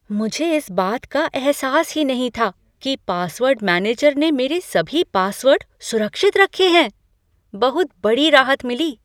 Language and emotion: Hindi, surprised